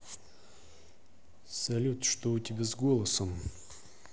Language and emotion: Russian, neutral